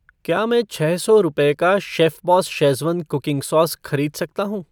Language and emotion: Hindi, neutral